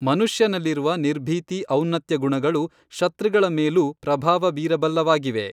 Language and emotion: Kannada, neutral